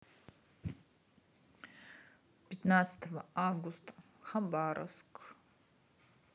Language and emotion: Russian, neutral